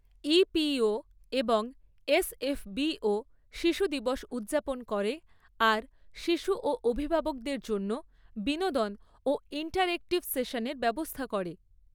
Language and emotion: Bengali, neutral